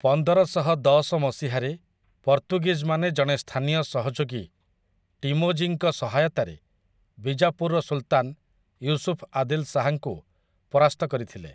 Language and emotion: Odia, neutral